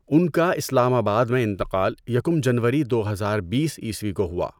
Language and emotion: Urdu, neutral